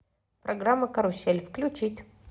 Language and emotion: Russian, positive